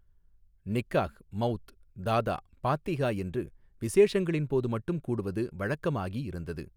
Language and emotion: Tamil, neutral